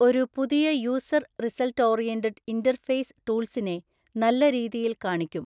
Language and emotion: Malayalam, neutral